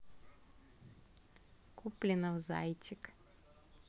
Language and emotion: Russian, neutral